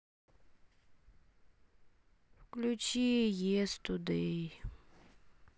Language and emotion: Russian, sad